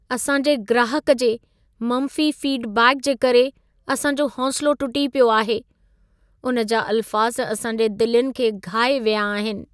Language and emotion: Sindhi, sad